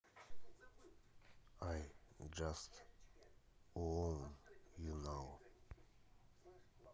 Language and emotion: Russian, neutral